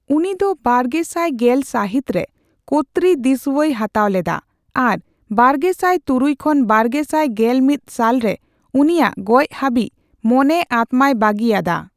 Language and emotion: Santali, neutral